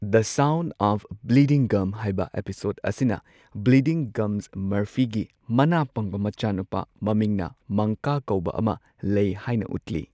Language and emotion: Manipuri, neutral